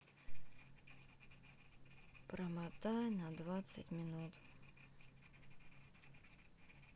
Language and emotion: Russian, sad